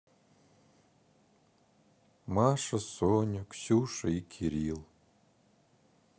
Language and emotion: Russian, sad